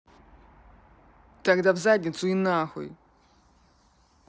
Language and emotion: Russian, angry